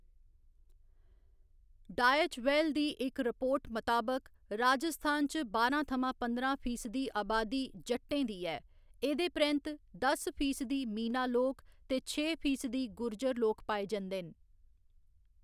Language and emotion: Dogri, neutral